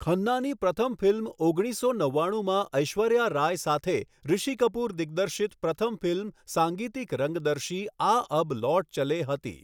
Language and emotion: Gujarati, neutral